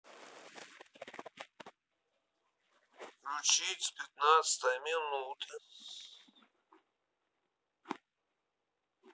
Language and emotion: Russian, neutral